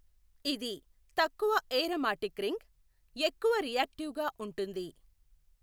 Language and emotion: Telugu, neutral